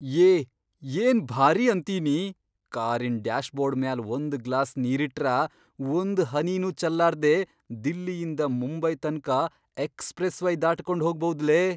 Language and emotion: Kannada, surprised